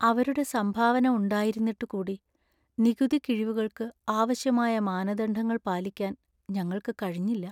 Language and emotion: Malayalam, sad